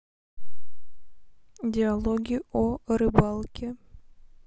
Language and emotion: Russian, neutral